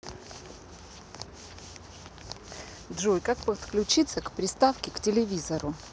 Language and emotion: Russian, neutral